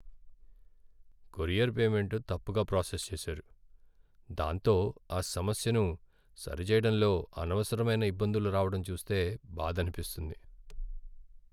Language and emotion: Telugu, sad